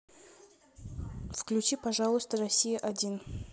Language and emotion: Russian, neutral